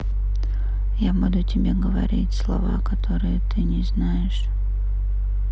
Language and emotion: Russian, neutral